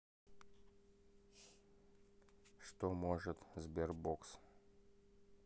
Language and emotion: Russian, neutral